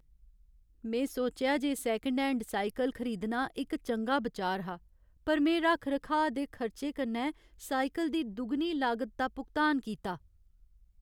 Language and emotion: Dogri, sad